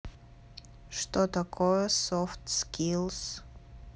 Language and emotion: Russian, neutral